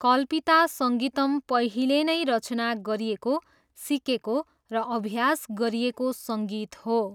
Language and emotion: Nepali, neutral